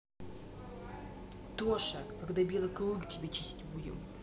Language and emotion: Russian, neutral